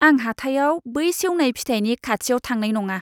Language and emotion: Bodo, disgusted